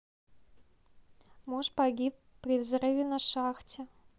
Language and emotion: Russian, neutral